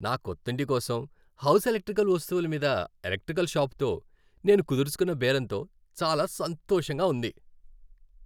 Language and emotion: Telugu, happy